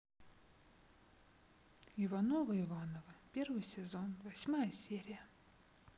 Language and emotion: Russian, sad